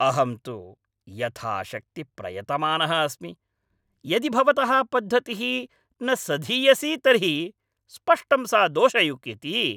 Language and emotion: Sanskrit, angry